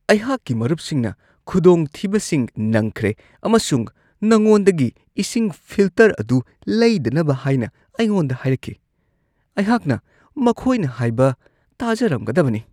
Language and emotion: Manipuri, disgusted